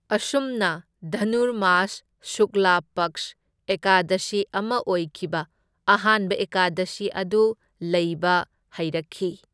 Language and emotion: Manipuri, neutral